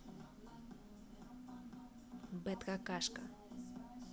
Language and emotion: Russian, neutral